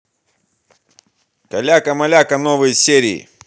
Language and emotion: Russian, positive